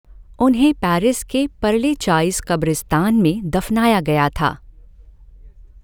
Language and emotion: Hindi, neutral